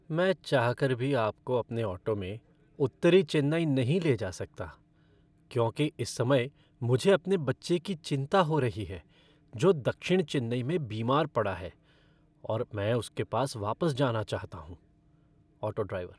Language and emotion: Hindi, sad